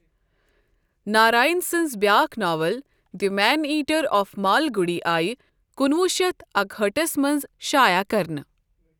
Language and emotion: Kashmiri, neutral